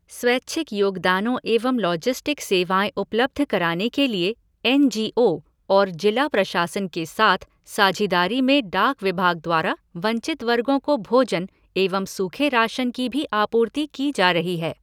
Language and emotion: Hindi, neutral